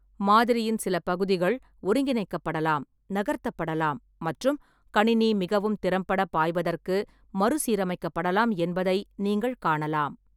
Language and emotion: Tamil, neutral